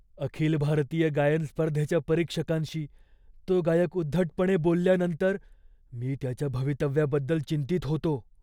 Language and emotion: Marathi, fearful